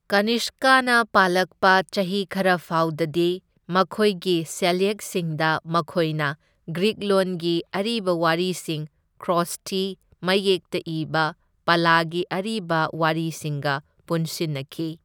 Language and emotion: Manipuri, neutral